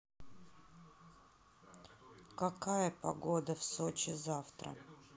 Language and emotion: Russian, neutral